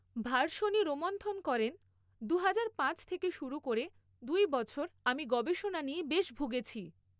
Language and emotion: Bengali, neutral